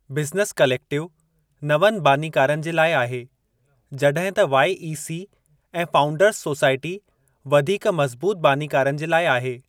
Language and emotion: Sindhi, neutral